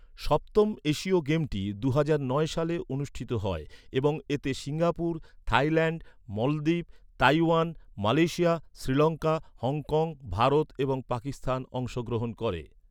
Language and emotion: Bengali, neutral